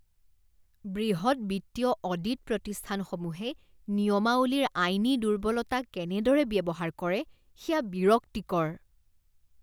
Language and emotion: Assamese, disgusted